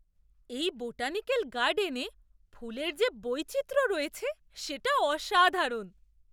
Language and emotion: Bengali, surprised